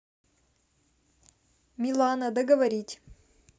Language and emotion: Russian, neutral